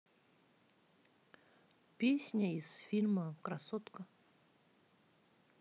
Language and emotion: Russian, neutral